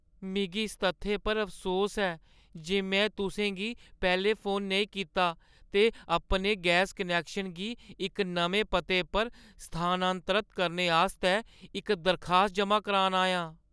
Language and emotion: Dogri, sad